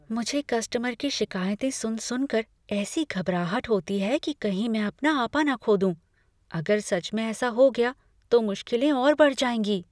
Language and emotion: Hindi, fearful